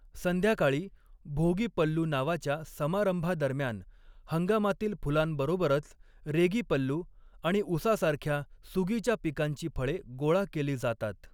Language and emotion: Marathi, neutral